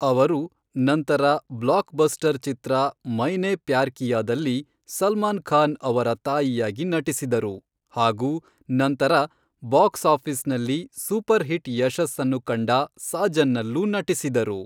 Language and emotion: Kannada, neutral